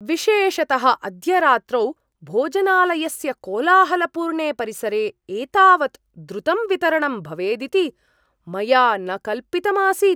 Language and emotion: Sanskrit, surprised